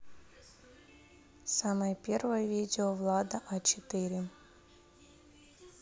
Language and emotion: Russian, neutral